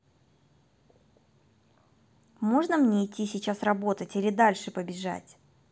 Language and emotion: Russian, angry